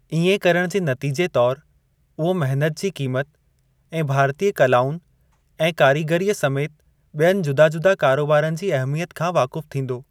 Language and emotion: Sindhi, neutral